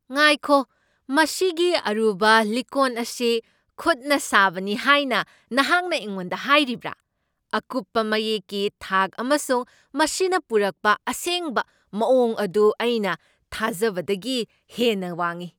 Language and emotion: Manipuri, surprised